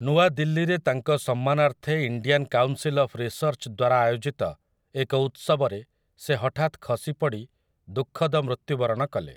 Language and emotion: Odia, neutral